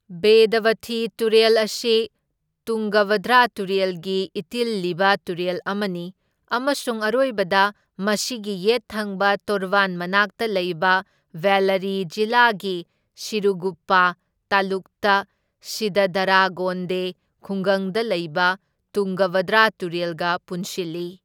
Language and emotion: Manipuri, neutral